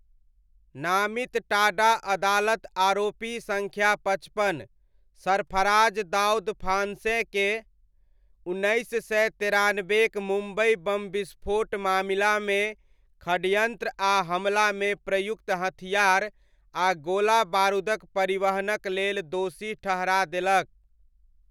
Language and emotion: Maithili, neutral